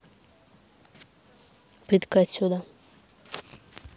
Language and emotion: Russian, neutral